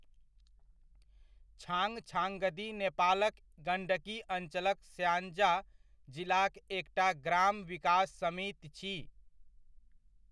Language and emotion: Maithili, neutral